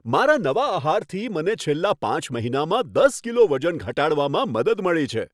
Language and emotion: Gujarati, happy